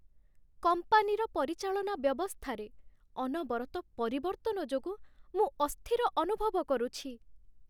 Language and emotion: Odia, sad